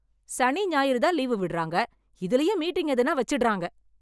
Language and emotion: Tamil, angry